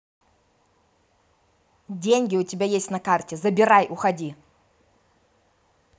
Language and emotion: Russian, angry